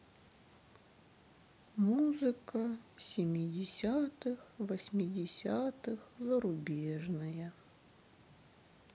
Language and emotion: Russian, sad